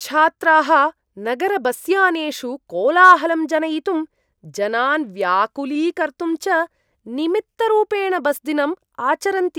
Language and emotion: Sanskrit, disgusted